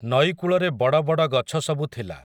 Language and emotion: Odia, neutral